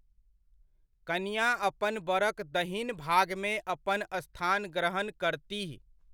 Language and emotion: Maithili, neutral